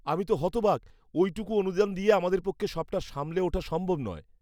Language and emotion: Bengali, disgusted